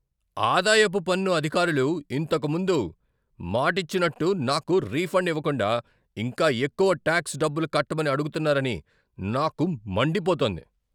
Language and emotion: Telugu, angry